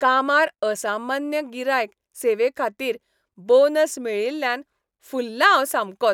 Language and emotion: Goan Konkani, happy